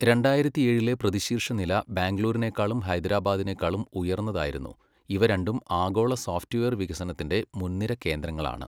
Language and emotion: Malayalam, neutral